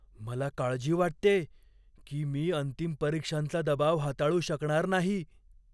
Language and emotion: Marathi, fearful